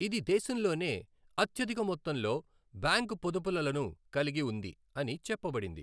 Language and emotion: Telugu, neutral